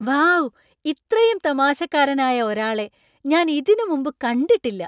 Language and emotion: Malayalam, surprised